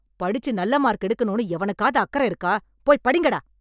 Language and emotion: Tamil, angry